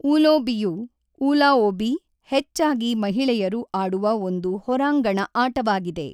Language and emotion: Kannada, neutral